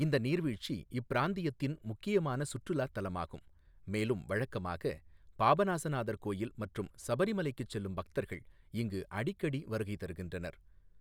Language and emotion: Tamil, neutral